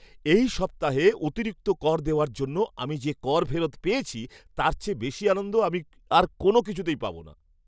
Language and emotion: Bengali, happy